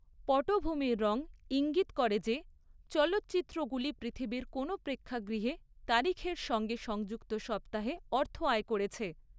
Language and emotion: Bengali, neutral